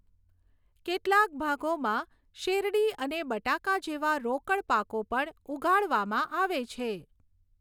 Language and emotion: Gujarati, neutral